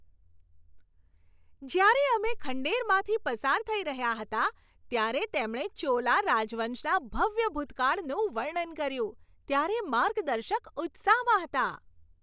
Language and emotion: Gujarati, happy